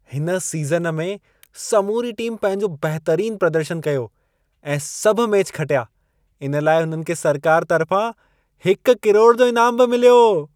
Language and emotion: Sindhi, happy